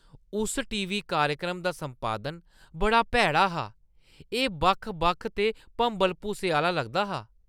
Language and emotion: Dogri, disgusted